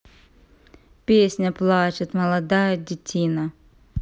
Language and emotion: Russian, neutral